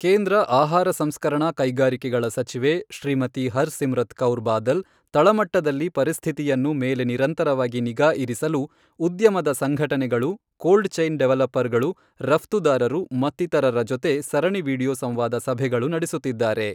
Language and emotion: Kannada, neutral